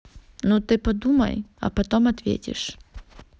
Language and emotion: Russian, neutral